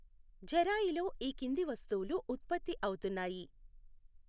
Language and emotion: Telugu, neutral